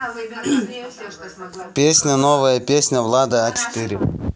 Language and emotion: Russian, neutral